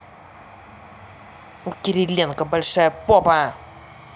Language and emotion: Russian, angry